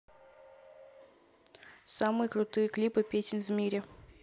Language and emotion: Russian, neutral